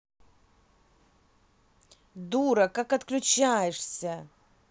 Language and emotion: Russian, angry